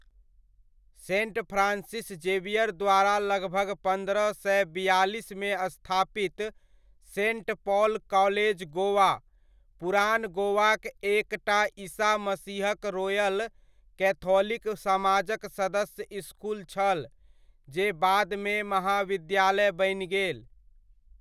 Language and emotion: Maithili, neutral